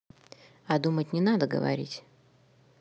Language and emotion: Russian, neutral